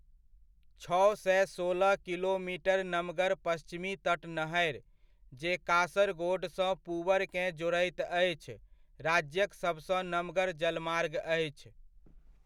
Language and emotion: Maithili, neutral